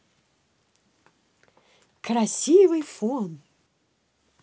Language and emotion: Russian, positive